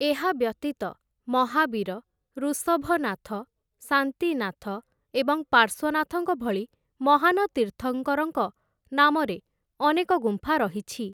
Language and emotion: Odia, neutral